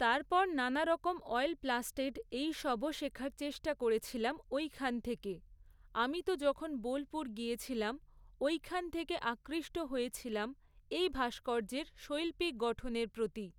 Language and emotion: Bengali, neutral